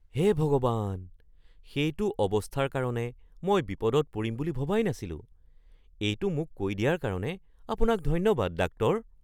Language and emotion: Assamese, surprised